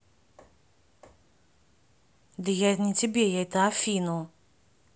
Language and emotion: Russian, neutral